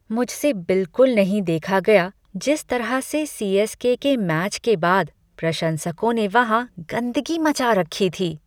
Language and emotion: Hindi, disgusted